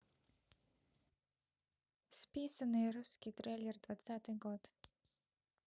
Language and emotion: Russian, neutral